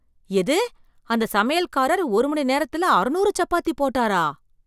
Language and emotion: Tamil, surprised